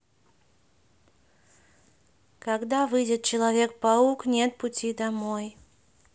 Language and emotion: Russian, neutral